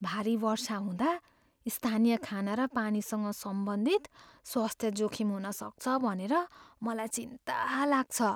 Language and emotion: Nepali, fearful